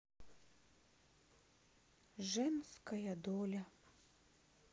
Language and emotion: Russian, sad